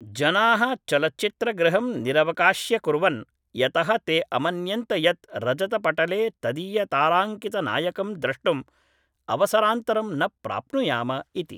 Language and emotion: Sanskrit, neutral